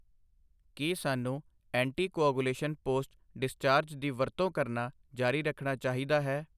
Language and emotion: Punjabi, neutral